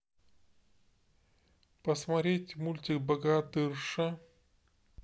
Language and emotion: Russian, neutral